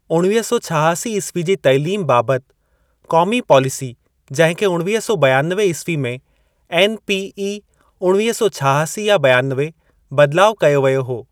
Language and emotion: Sindhi, neutral